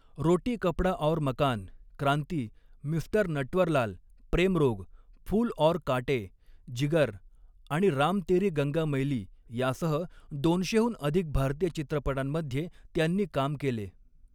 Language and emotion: Marathi, neutral